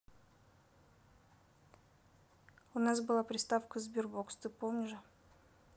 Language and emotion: Russian, neutral